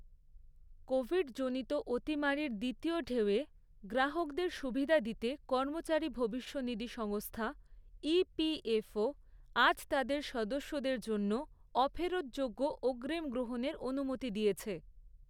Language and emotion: Bengali, neutral